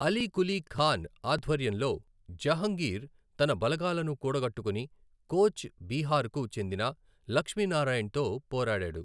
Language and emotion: Telugu, neutral